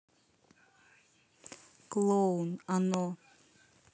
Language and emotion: Russian, neutral